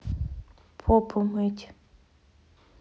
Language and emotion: Russian, neutral